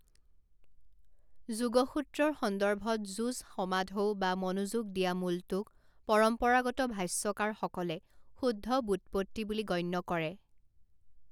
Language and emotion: Assamese, neutral